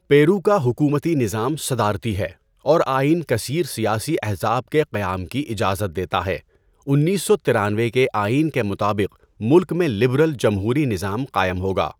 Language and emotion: Urdu, neutral